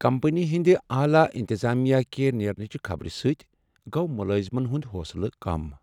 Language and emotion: Kashmiri, sad